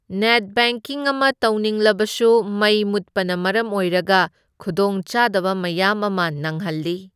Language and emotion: Manipuri, neutral